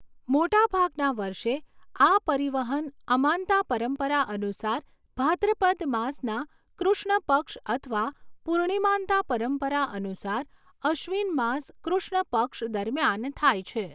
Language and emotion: Gujarati, neutral